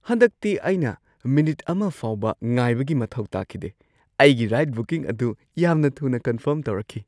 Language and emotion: Manipuri, surprised